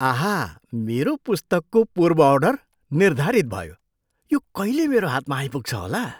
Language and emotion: Nepali, surprised